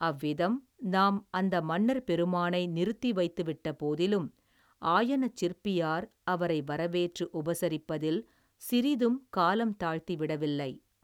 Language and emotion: Tamil, neutral